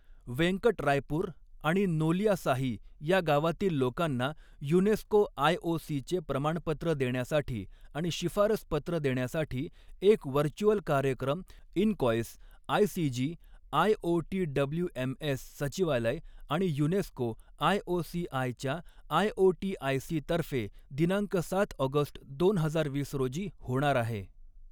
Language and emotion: Marathi, neutral